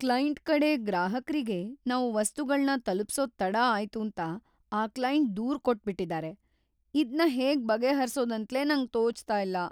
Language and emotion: Kannada, fearful